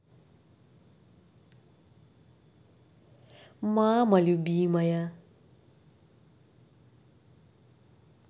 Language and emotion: Russian, positive